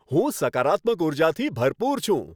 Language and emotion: Gujarati, happy